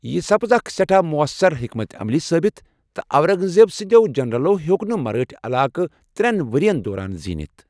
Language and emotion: Kashmiri, neutral